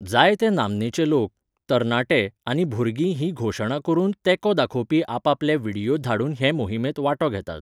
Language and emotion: Goan Konkani, neutral